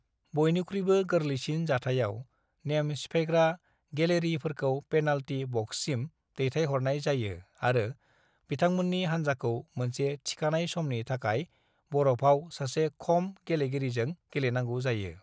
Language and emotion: Bodo, neutral